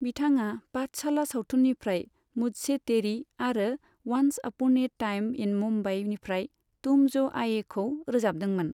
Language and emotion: Bodo, neutral